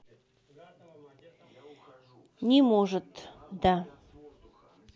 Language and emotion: Russian, neutral